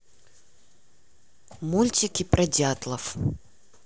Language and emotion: Russian, neutral